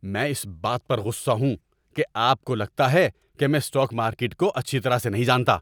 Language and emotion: Urdu, angry